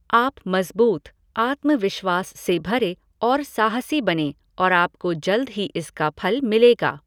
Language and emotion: Hindi, neutral